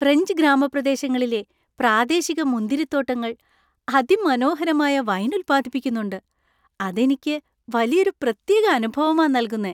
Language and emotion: Malayalam, happy